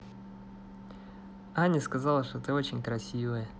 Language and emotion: Russian, positive